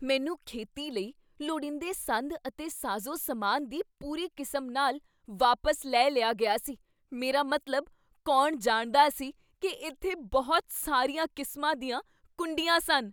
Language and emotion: Punjabi, surprised